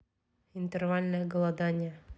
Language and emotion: Russian, neutral